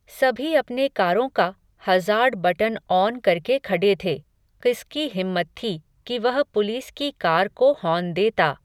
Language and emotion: Hindi, neutral